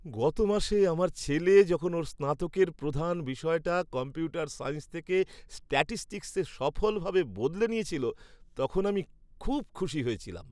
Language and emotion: Bengali, happy